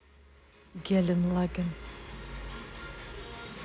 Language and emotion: Russian, neutral